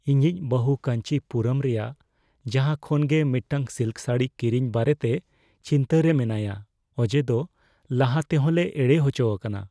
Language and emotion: Santali, fearful